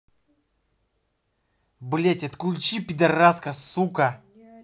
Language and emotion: Russian, angry